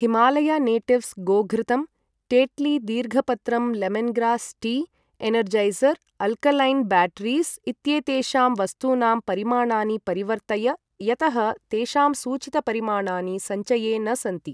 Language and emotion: Sanskrit, neutral